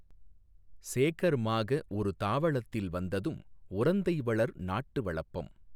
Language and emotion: Tamil, neutral